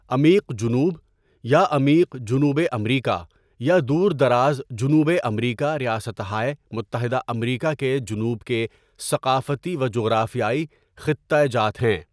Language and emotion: Urdu, neutral